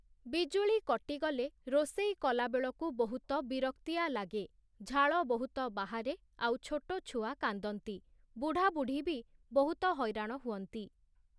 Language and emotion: Odia, neutral